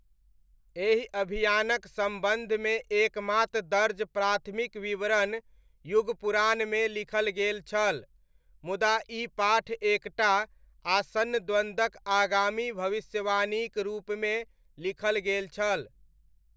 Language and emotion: Maithili, neutral